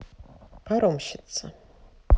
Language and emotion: Russian, neutral